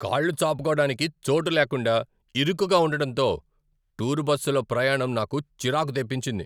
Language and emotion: Telugu, angry